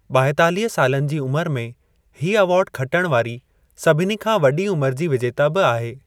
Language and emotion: Sindhi, neutral